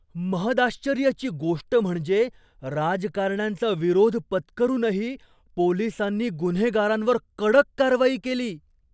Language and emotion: Marathi, surprised